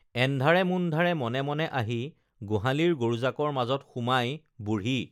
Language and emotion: Assamese, neutral